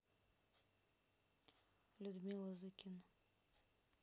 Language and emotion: Russian, neutral